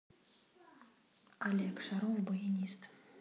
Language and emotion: Russian, neutral